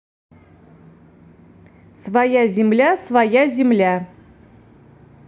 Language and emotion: Russian, neutral